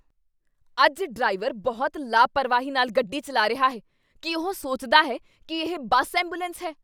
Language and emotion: Punjabi, angry